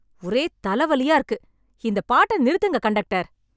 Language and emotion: Tamil, angry